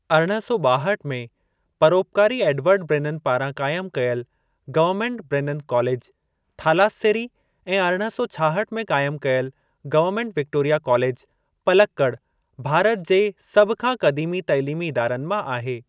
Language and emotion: Sindhi, neutral